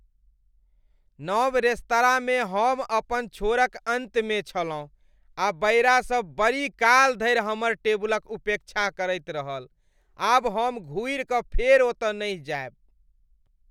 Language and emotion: Maithili, disgusted